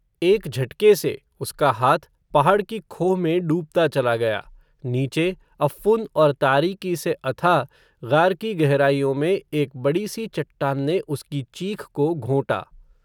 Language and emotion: Hindi, neutral